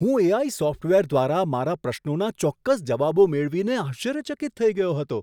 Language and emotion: Gujarati, surprised